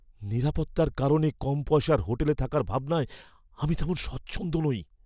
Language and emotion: Bengali, fearful